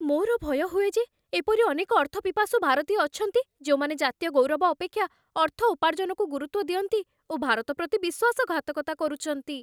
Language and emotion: Odia, fearful